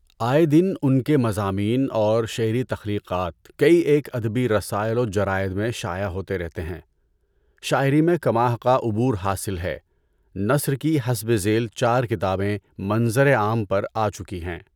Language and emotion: Urdu, neutral